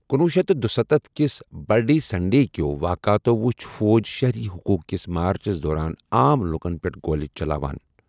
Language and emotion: Kashmiri, neutral